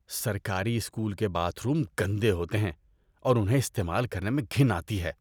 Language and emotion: Urdu, disgusted